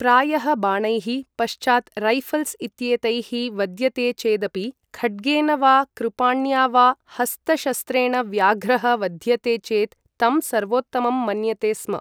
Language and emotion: Sanskrit, neutral